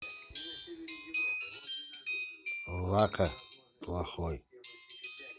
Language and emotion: Russian, neutral